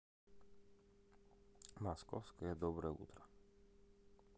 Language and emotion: Russian, neutral